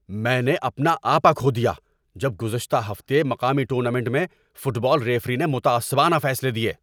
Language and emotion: Urdu, angry